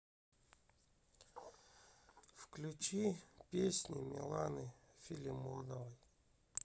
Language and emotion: Russian, sad